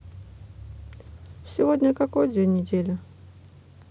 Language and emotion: Russian, neutral